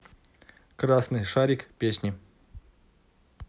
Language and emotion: Russian, neutral